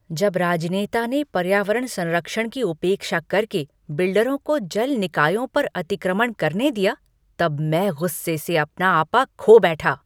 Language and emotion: Hindi, angry